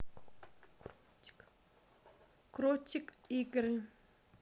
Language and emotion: Russian, neutral